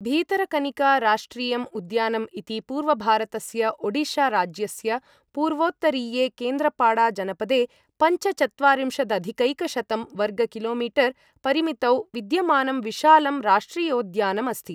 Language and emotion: Sanskrit, neutral